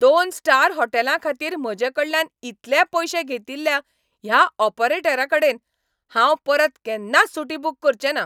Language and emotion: Goan Konkani, angry